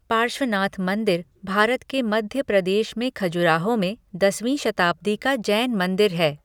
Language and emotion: Hindi, neutral